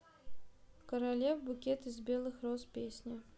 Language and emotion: Russian, neutral